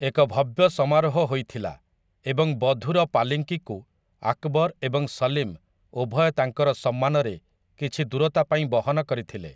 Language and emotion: Odia, neutral